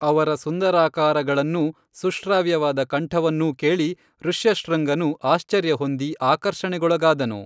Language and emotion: Kannada, neutral